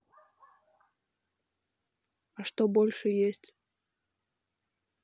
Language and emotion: Russian, neutral